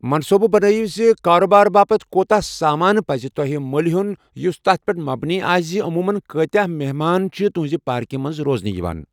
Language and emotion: Kashmiri, neutral